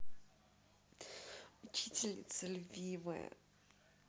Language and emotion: Russian, positive